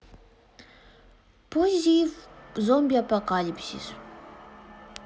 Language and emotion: Russian, neutral